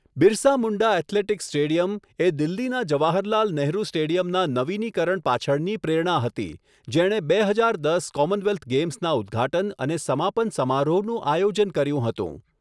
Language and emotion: Gujarati, neutral